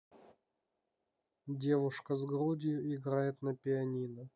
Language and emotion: Russian, neutral